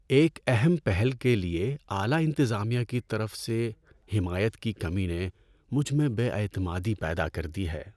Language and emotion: Urdu, sad